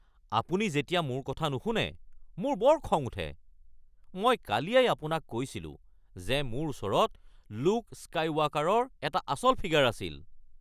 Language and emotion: Assamese, angry